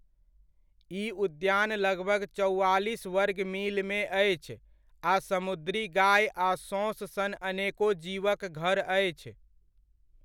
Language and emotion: Maithili, neutral